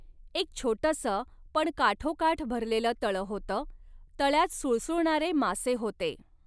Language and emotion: Marathi, neutral